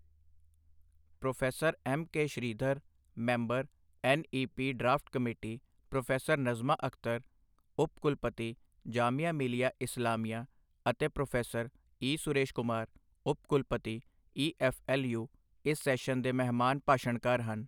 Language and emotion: Punjabi, neutral